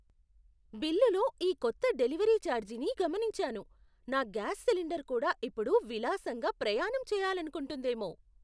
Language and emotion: Telugu, surprised